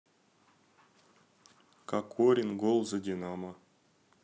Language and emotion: Russian, neutral